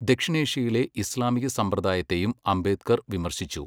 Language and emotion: Malayalam, neutral